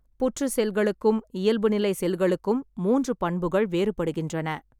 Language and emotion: Tamil, neutral